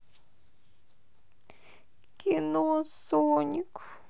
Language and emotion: Russian, sad